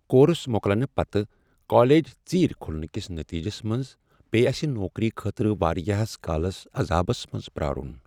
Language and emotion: Kashmiri, sad